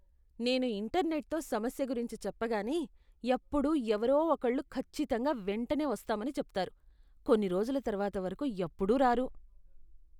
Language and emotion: Telugu, disgusted